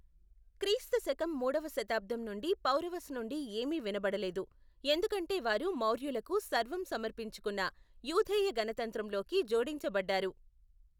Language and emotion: Telugu, neutral